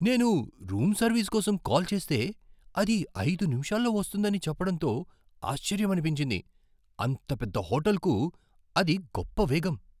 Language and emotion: Telugu, surprised